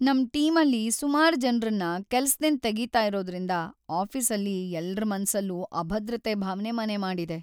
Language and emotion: Kannada, sad